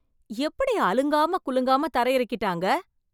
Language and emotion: Tamil, surprised